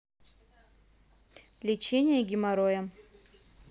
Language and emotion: Russian, neutral